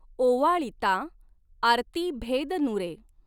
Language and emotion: Marathi, neutral